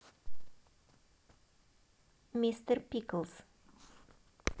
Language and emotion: Russian, positive